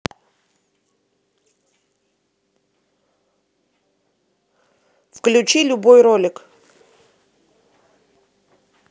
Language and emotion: Russian, neutral